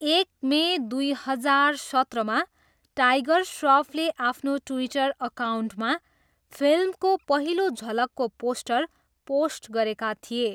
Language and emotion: Nepali, neutral